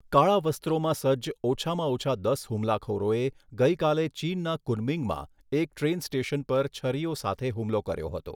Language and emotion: Gujarati, neutral